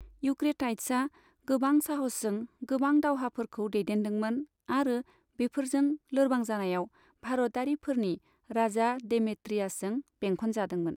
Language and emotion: Bodo, neutral